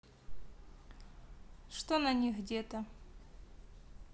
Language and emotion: Russian, neutral